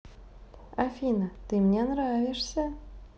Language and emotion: Russian, positive